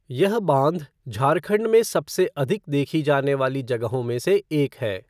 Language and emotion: Hindi, neutral